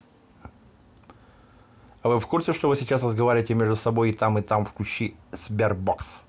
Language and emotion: Russian, neutral